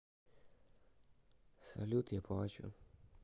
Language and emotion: Russian, neutral